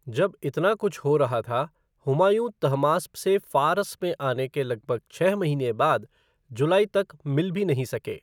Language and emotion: Hindi, neutral